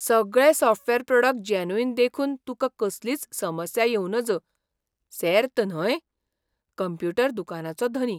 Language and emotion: Goan Konkani, surprised